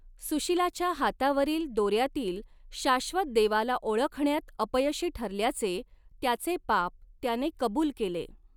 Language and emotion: Marathi, neutral